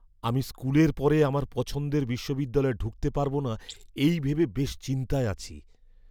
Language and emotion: Bengali, fearful